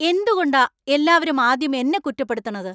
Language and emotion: Malayalam, angry